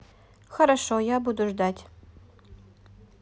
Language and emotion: Russian, neutral